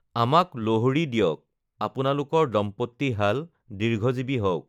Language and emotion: Assamese, neutral